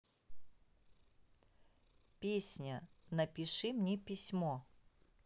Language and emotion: Russian, neutral